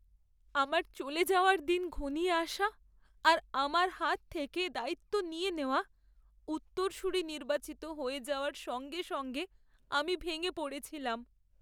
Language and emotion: Bengali, sad